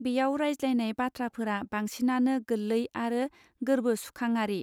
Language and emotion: Bodo, neutral